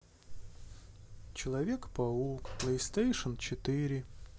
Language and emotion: Russian, sad